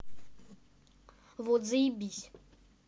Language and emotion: Russian, angry